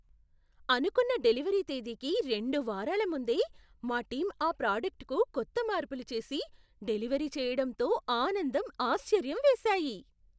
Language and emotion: Telugu, surprised